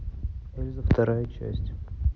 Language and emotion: Russian, neutral